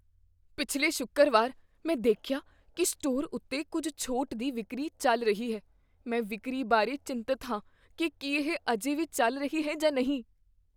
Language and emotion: Punjabi, fearful